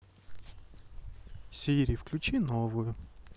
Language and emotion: Russian, sad